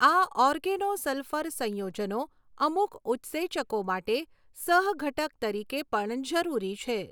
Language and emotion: Gujarati, neutral